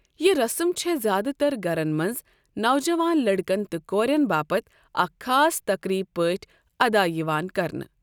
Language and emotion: Kashmiri, neutral